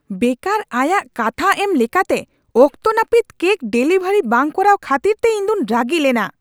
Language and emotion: Santali, angry